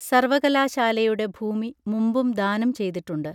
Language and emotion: Malayalam, neutral